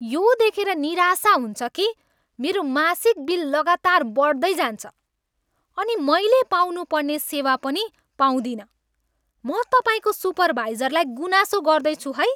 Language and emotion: Nepali, angry